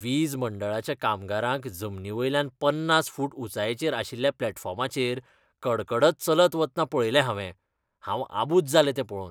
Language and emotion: Goan Konkani, disgusted